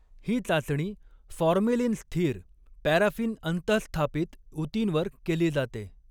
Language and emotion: Marathi, neutral